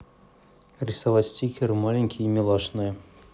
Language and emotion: Russian, neutral